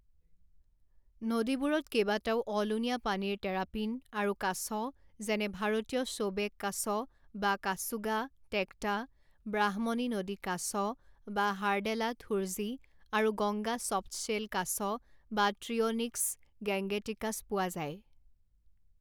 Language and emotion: Assamese, neutral